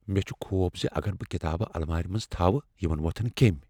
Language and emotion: Kashmiri, fearful